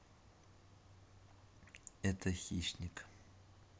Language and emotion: Russian, neutral